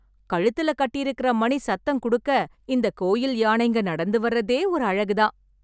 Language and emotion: Tamil, happy